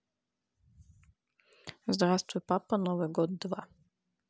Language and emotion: Russian, neutral